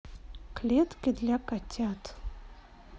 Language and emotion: Russian, neutral